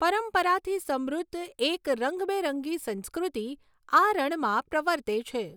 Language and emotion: Gujarati, neutral